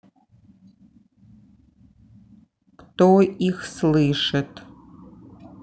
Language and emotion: Russian, neutral